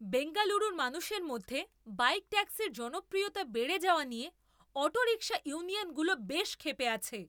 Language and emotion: Bengali, angry